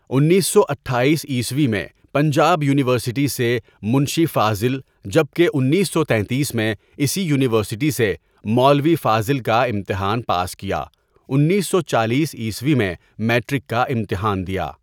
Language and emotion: Urdu, neutral